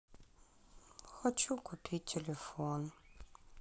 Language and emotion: Russian, sad